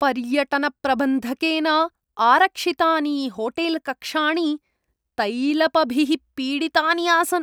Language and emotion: Sanskrit, disgusted